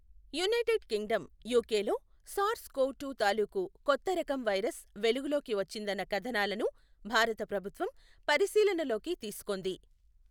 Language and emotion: Telugu, neutral